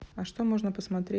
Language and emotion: Russian, neutral